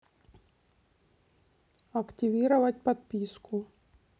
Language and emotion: Russian, neutral